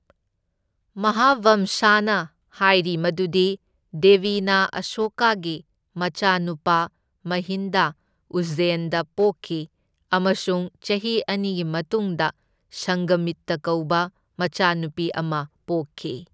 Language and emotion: Manipuri, neutral